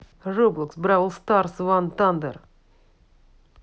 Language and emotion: Russian, neutral